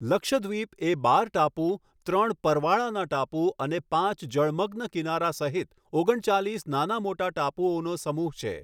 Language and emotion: Gujarati, neutral